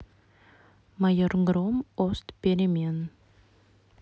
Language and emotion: Russian, neutral